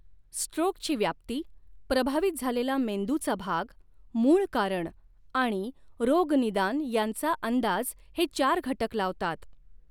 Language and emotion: Marathi, neutral